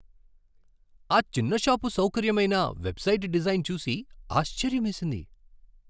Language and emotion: Telugu, surprised